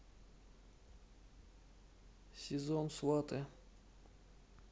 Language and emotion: Russian, neutral